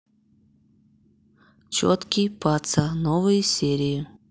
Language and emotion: Russian, neutral